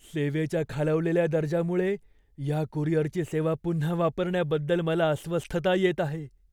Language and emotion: Marathi, fearful